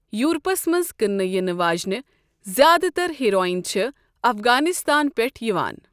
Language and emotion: Kashmiri, neutral